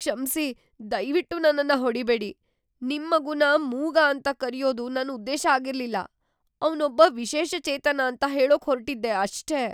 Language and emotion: Kannada, fearful